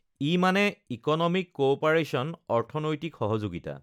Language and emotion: Assamese, neutral